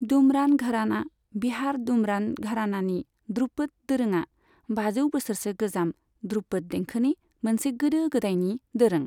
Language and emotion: Bodo, neutral